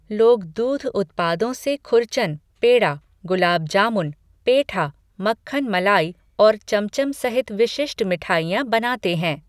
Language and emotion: Hindi, neutral